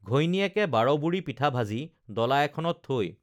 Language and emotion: Assamese, neutral